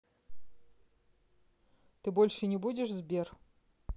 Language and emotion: Russian, neutral